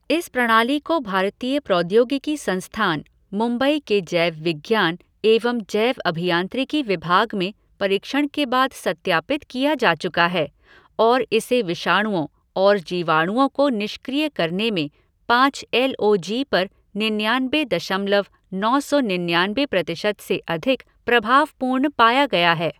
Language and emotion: Hindi, neutral